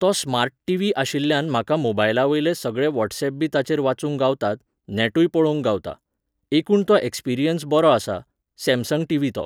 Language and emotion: Goan Konkani, neutral